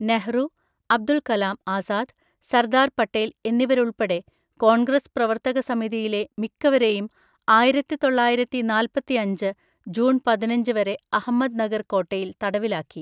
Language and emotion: Malayalam, neutral